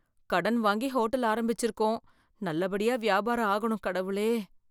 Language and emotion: Tamil, fearful